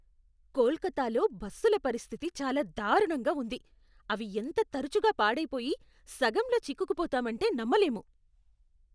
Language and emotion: Telugu, disgusted